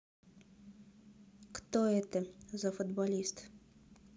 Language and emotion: Russian, neutral